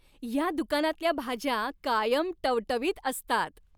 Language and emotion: Marathi, happy